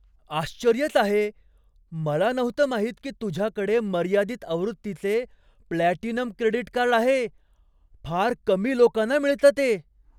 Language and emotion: Marathi, surprised